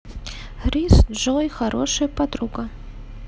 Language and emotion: Russian, neutral